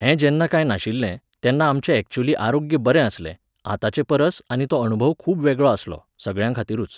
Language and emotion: Goan Konkani, neutral